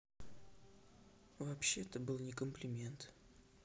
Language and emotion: Russian, sad